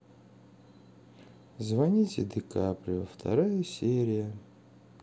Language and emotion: Russian, sad